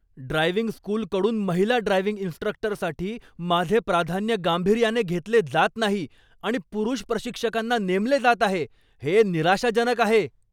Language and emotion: Marathi, angry